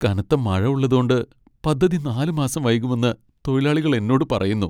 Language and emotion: Malayalam, sad